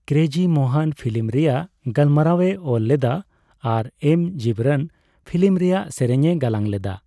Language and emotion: Santali, neutral